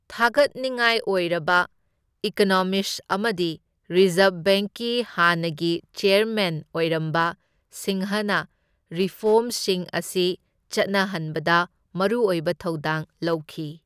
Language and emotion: Manipuri, neutral